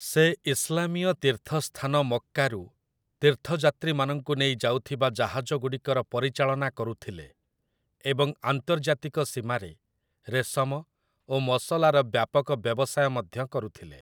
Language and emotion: Odia, neutral